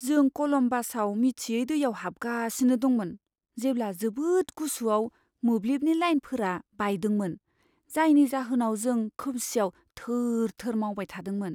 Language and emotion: Bodo, fearful